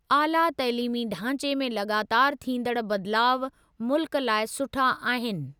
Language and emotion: Sindhi, neutral